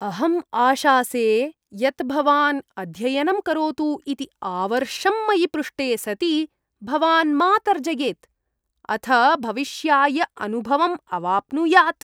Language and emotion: Sanskrit, disgusted